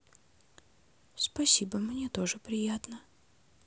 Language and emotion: Russian, neutral